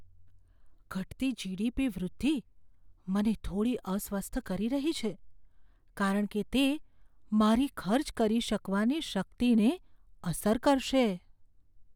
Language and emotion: Gujarati, fearful